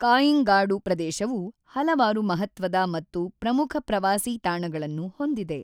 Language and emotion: Kannada, neutral